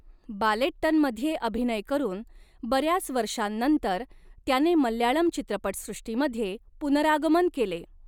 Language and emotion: Marathi, neutral